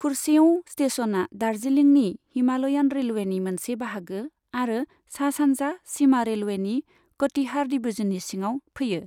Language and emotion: Bodo, neutral